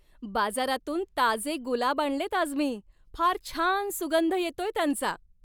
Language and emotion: Marathi, happy